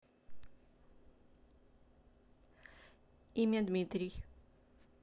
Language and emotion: Russian, neutral